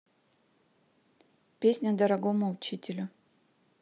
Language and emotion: Russian, neutral